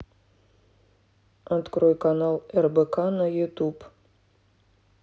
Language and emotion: Russian, neutral